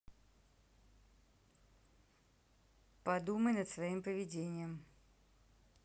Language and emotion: Russian, neutral